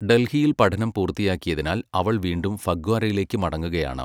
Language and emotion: Malayalam, neutral